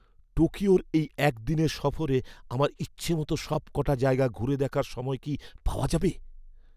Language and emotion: Bengali, fearful